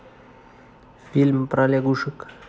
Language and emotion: Russian, neutral